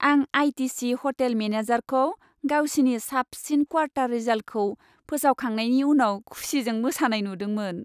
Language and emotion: Bodo, happy